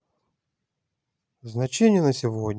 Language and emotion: Russian, neutral